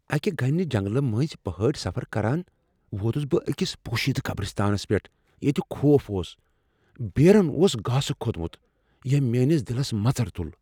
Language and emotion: Kashmiri, fearful